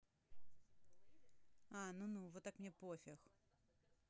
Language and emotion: Russian, neutral